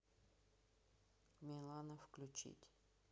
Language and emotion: Russian, neutral